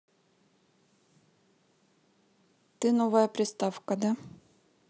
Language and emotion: Russian, neutral